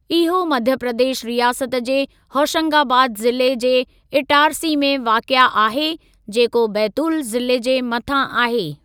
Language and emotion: Sindhi, neutral